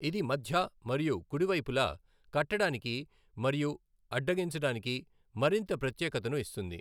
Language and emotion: Telugu, neutral